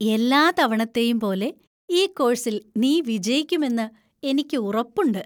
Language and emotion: Malayalam, happy